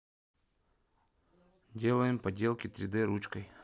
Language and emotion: Russian, neutral